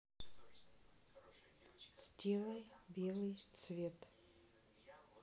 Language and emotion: Russian, neutral